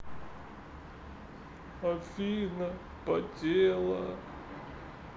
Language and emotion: Russian, sad